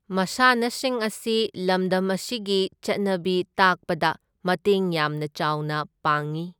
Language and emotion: Manipuri, neutral